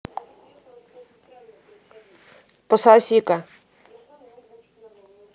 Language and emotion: Russian, angry